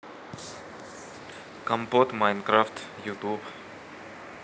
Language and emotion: Russian, neutral